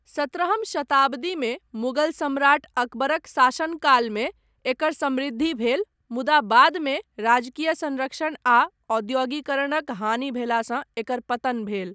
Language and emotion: Maithili, neutral